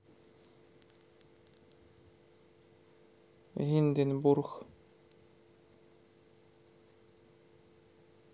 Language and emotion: Russian, neutral